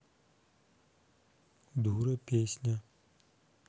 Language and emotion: Russian, neutral